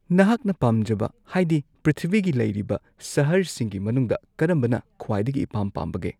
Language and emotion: Manipuri, neutral